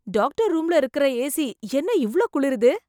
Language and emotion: Tamil, surprised